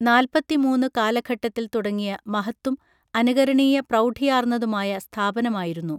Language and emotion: Malayalam, neutral